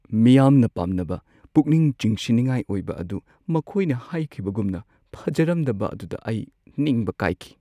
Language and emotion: Manipuri, sad